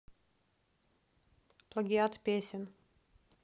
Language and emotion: Russian, neutral